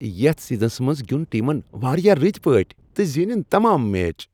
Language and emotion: Kashmiri, happy